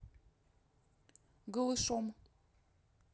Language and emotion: Russian, neutral